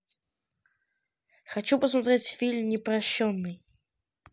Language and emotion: Russian, neutral